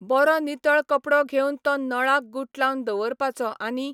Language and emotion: Goan Konkani, neutral